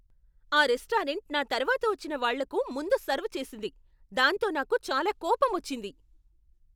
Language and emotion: Telugu, angry